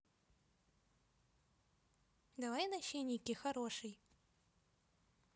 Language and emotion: Russian, positive